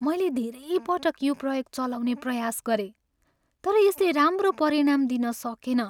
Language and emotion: Nepali, sad